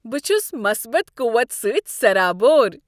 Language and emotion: Kashmiri, happy